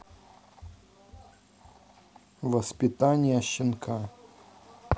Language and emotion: Russian, neutral